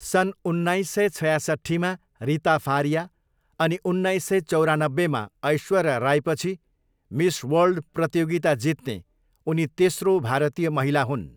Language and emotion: Nepali, neutral